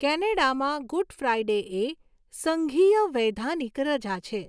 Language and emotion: Gujarati, neutral